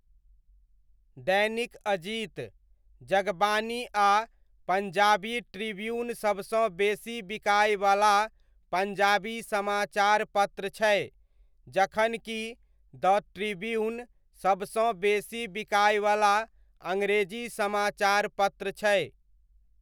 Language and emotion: Maithili, neutral